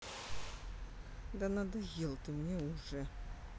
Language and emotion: Russian, angry